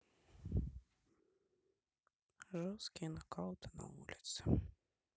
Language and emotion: Russian, neutral